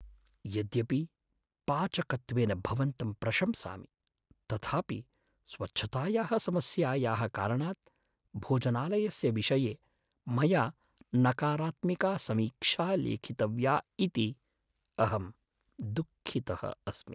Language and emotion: Sanskrit, sad